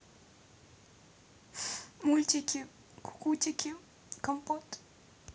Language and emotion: Russian, sad